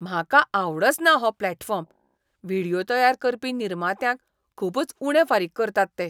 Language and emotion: Goan Konkani, disgusted